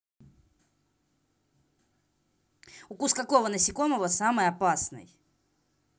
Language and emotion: Russian, angry